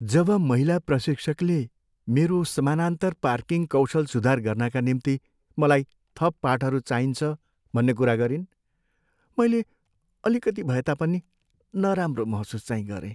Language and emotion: Nepali, sad